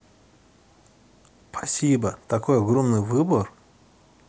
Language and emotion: Russian, positive